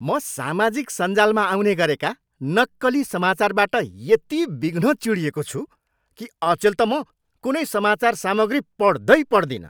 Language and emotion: Nepali, angry